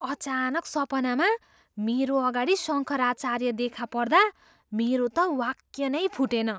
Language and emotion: Nepali, surprised